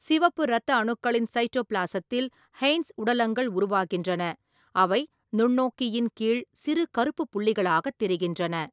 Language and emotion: Tamil, neutral